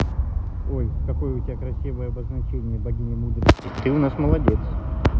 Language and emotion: Russian, positive